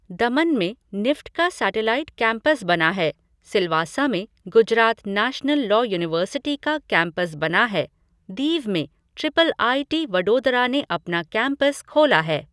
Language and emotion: Hindi, neutral